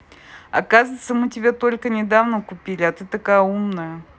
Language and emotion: Russian, positive